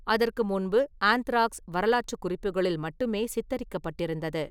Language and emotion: Tamil, neutral